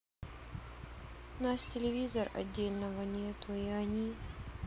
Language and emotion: Russian, sad